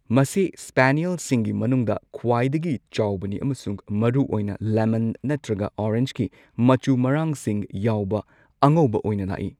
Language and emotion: Manipuri, neutral